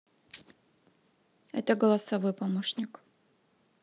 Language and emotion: Russian, neutral